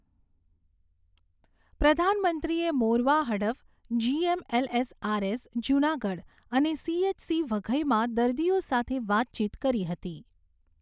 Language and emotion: Gujarati, neutral